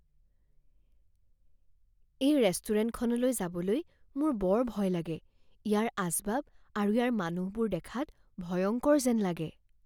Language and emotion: Assamese, fearful